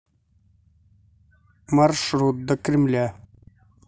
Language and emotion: Russian, neutral